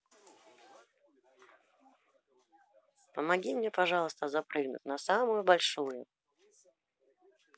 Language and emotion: Russian, neutral